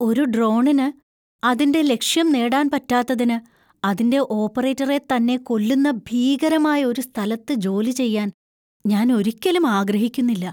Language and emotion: Malayalam, fearful